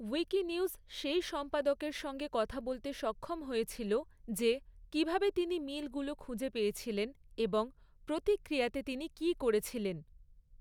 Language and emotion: Bengali, neutral